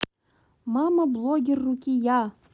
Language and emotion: Russian, neutral